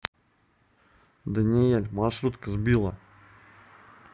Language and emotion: Russian, neutral